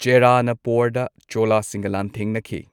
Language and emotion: Manipuri, neutral